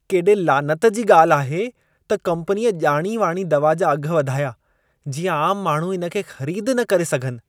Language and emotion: Sindhi, disgusted